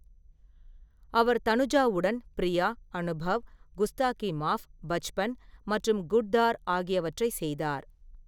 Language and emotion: Tamil, neutral